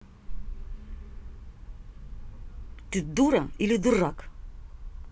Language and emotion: Russian, angry